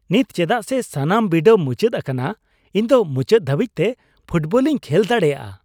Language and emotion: Santali, happy